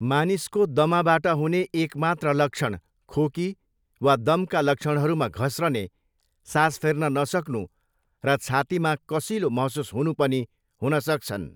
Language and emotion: Nepali, neutral